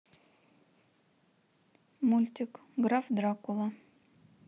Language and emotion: Russian, neutral